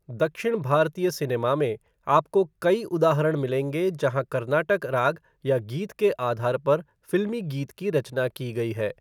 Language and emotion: Hindi, neutral